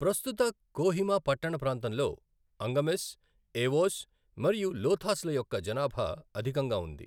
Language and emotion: Telugu, neutral